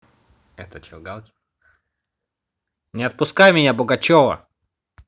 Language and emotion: Russian, neutral